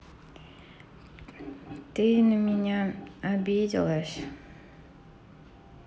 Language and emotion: Russian, sad